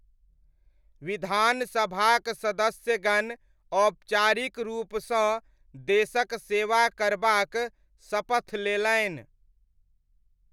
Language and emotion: Maithili, neutral